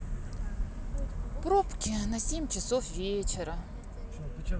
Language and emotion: Russian, sad